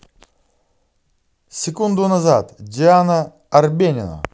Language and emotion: Russian, positive